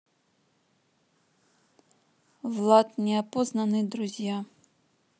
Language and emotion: Russian, neutral